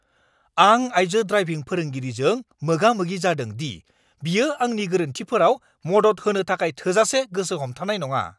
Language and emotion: Bodo, angry